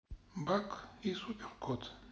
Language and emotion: Russian, neutral